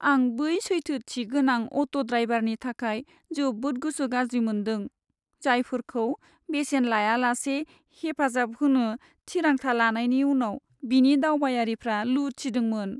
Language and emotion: Bodo, sad